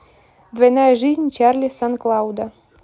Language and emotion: Russian, neutral